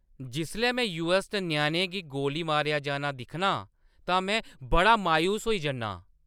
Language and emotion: Dogri, angry